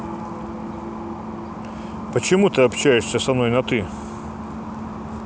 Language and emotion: Russian, angry